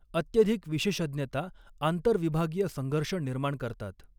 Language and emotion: Marathi, neutral